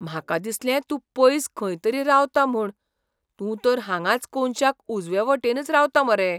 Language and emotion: Goan Konkani, surprised